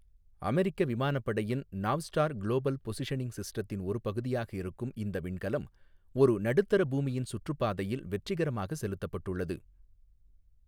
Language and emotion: Tamil, neutral